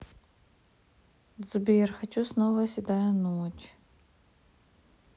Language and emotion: Russian, sad